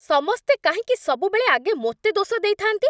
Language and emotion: Odia, angry